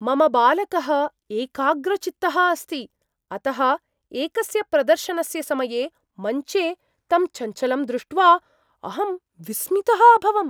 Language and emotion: Sanskrit, surprised